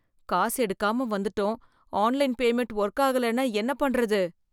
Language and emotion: Tamil, fearful